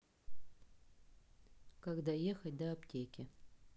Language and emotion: Russian, neutral